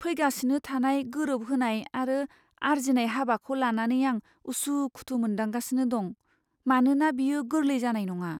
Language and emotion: Bodo, fearful